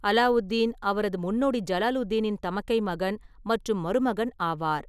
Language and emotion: Tamil, neutral